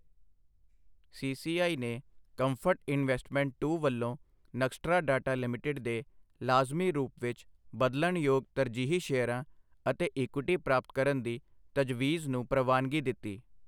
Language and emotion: Punjabi, neutral